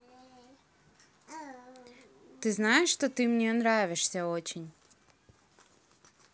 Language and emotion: Russian, neutral